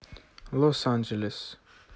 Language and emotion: Russian, neutral